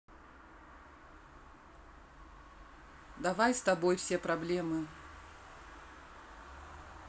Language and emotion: Russian, neutral